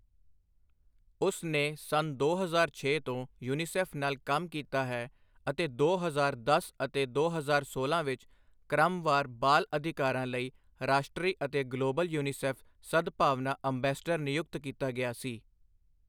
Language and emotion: Punjabi, neutral